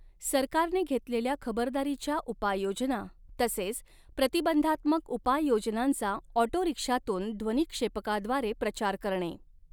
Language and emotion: Marathi, neutral